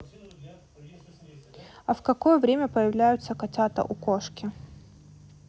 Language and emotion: Russian, neutral